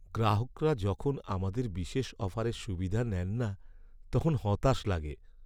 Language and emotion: Bengali, sad